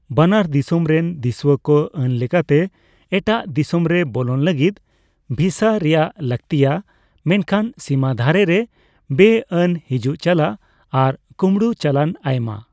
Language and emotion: Santali, neutral